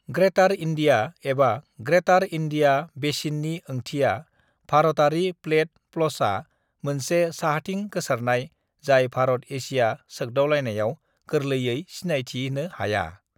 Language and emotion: Bodo, neutral